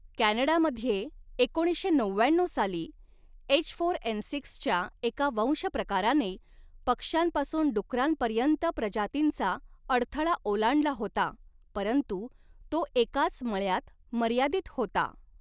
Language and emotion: Marathi, neutral